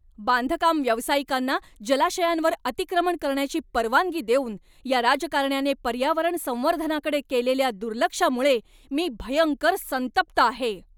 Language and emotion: Marathi, angry